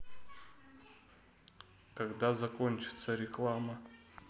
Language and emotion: Russian, neutral